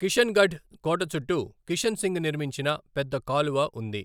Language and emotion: Telugu, neutral